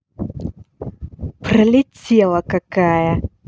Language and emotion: Russian, angry